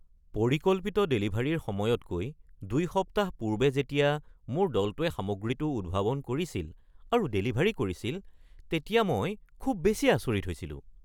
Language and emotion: Assamese, surprised